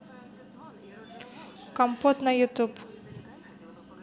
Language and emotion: Russian, neutral